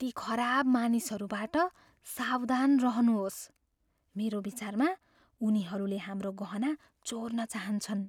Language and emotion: Nepali, fearful